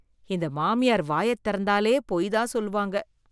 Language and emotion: Tamil, disgusted